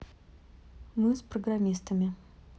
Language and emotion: Russian, neutral